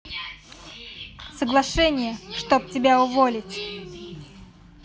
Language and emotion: Russian, neutral